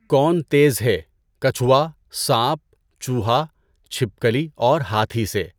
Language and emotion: Urdu, neutral